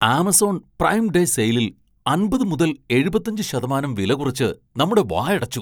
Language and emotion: Malayalam, surprised